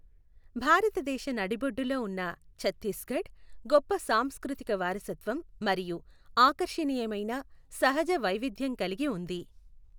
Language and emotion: Telugu, neutral